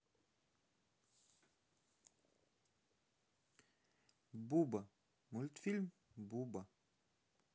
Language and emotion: Russian, neutral